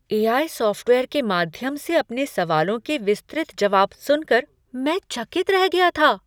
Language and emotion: Hindi, surprised